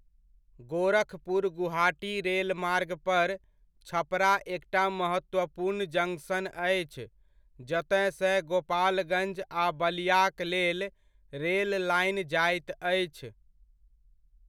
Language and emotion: Maithili, neutral